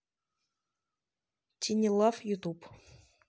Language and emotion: Russian, neutral